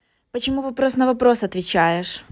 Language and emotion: Russian, angry